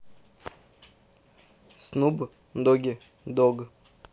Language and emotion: Russian, neutral